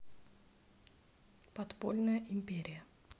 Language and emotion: Russian, neutral